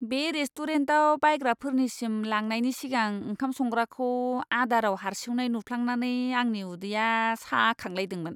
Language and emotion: Bodo, disgusted